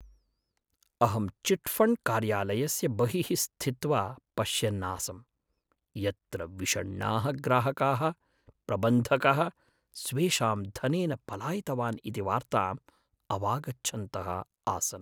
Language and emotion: Sanskrit, sad